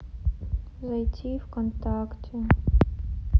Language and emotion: Russian, sad